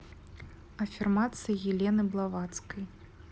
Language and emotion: Russian, neutral